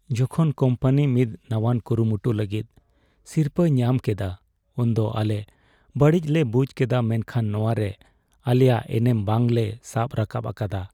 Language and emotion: Santali, sad